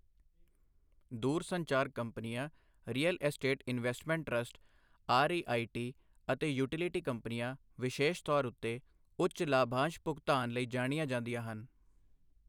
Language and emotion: Punjabi, neutral